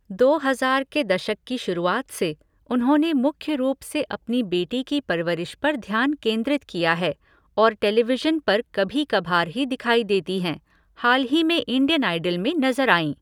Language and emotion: Hindi, neutral